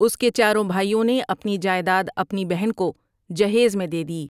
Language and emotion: Urdu, neutral